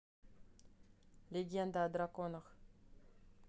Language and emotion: Russian, neutral